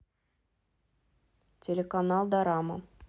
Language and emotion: Russian, neutral